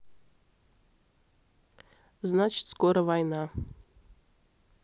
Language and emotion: Russian, neutral